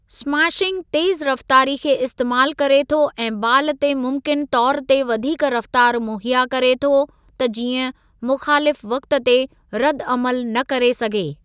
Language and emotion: Sindhi, neutral